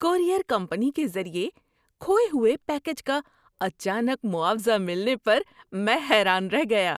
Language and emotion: Urdu, surprised